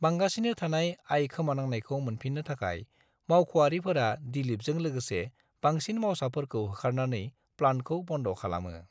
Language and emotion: Bodo, neutral